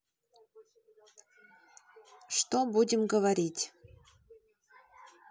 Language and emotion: Russian, neutral